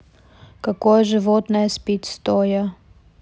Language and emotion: Russian, neutral